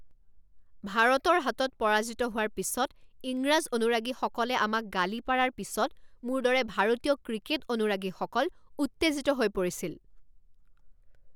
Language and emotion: Assamese, angry